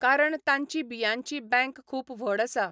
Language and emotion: Goan Konkani, neutral